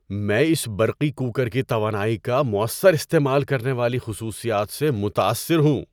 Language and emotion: Urdu, surprised